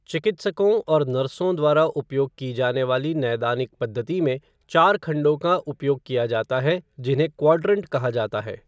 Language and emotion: Hindi, neutral